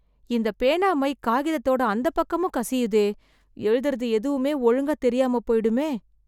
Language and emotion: Tamil, fearful